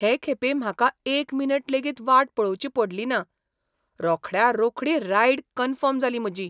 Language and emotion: Goan Konkani, surprised